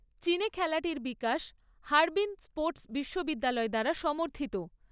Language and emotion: Bengali, neutral